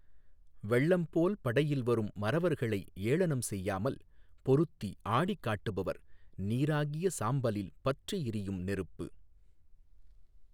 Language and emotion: Tamil, neutral